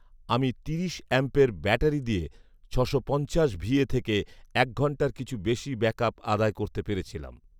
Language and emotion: Bengali, neutral